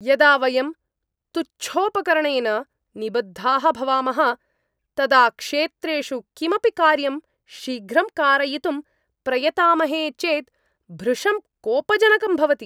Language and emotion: Sanskrit, angry